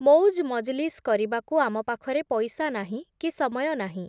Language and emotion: Odia, neutral